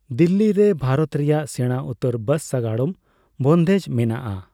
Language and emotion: Santali, neutral